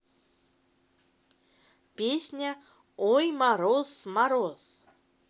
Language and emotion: Russian, positive